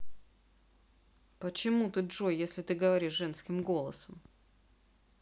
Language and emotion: Russian, neutral